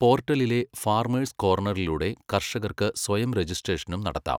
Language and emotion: Malayalam, neutral